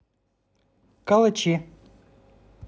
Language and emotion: Russian, neutral